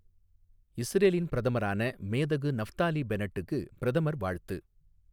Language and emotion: Tamil, neutral